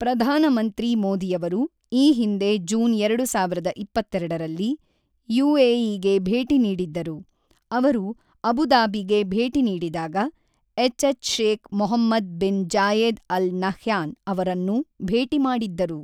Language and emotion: Kannada, neutral